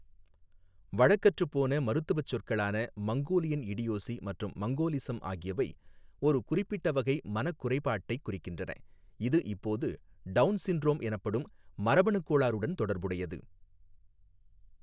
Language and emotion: Tamil, neutral